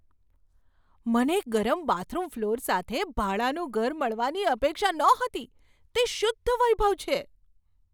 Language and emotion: Gujarati, surprised